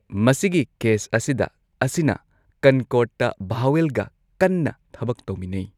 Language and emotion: Manipuri, neutral